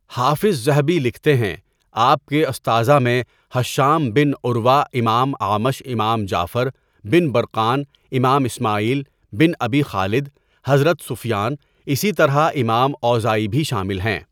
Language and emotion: Urdu, neutral